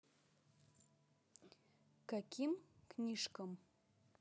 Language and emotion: Russian, neutral